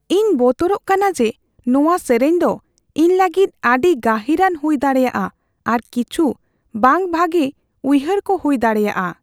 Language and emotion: Santali, fearful